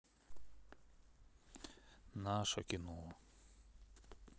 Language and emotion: Russian, neutral